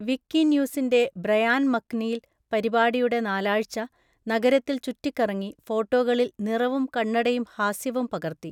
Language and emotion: Malayalam, neutral